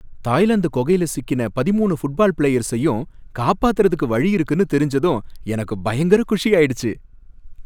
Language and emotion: Tamil, happy